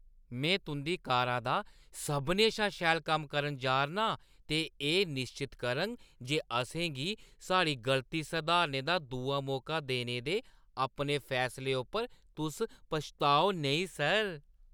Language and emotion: Dogri, happy